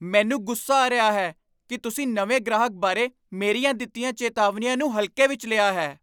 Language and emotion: Punjabi, angry